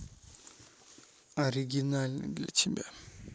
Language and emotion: Russian, neutral